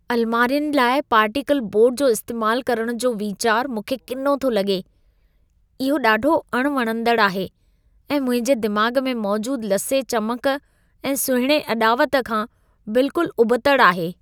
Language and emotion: Sindhi, disgusted